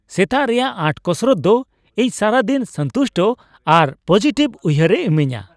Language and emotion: Santali, happy